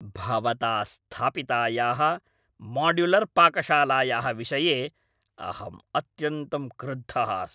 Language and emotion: Sanskrit, angry